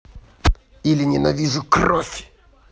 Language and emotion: Russian, angry